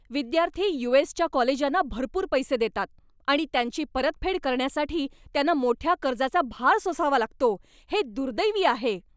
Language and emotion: Marathi, angry